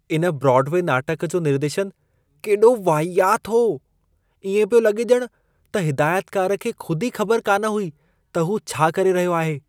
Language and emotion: Sindhi, disgusted